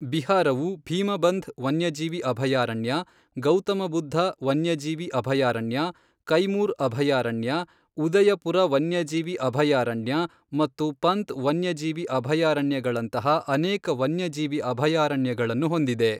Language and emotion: Kannada, neutral